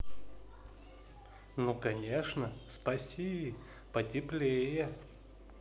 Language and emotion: Russian, positive